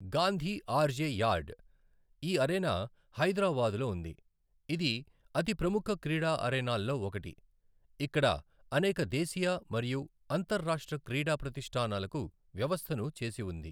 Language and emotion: Telugu, neutral